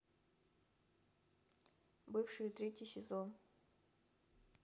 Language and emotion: Russian, neutral